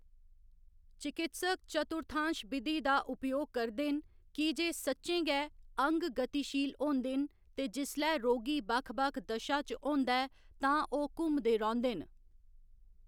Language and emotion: Dogri, neutral